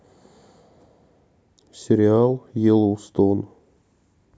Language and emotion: Russian, neutral